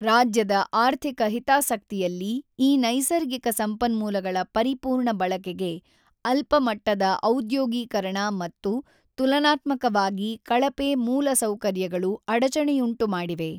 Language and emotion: Kannada, neutral